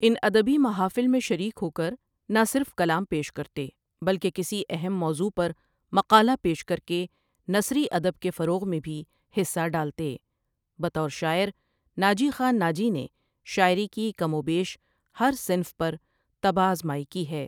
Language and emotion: Urdu, neutral